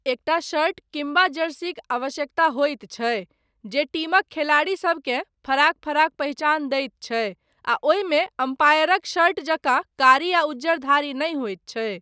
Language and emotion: Maithili, neutral